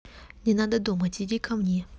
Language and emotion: Russian, neutral